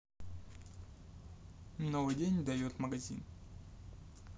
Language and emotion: Russian, neutral